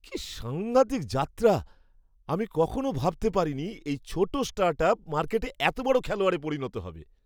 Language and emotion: Bengali, surprised